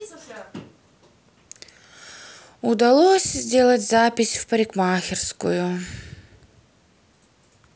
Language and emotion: Russian, sad